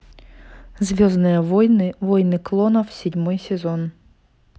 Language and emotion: Russian, neutral